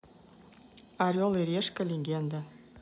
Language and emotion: Russian, neutral